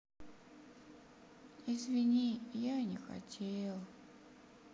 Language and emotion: Russian, sad